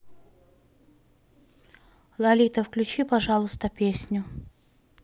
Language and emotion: Russian, neutral